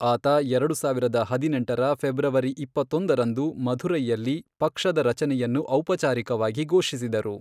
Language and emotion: Kannada, neutral